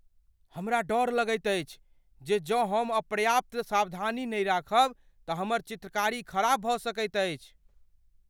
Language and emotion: Maithili, fearful